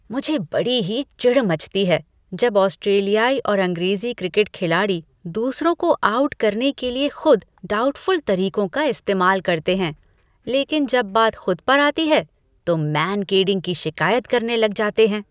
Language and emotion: Hindi, disgusted